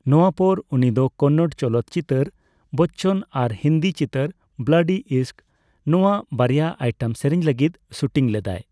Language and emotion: Santali, neutral